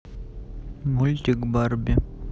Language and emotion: Russian, neutral